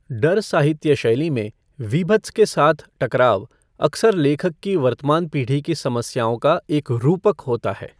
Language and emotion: Hindi, neutral